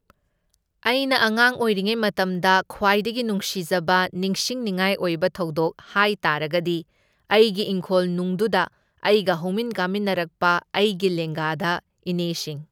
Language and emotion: Manipuri, neutral